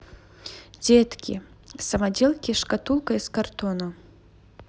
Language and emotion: Russian, neutral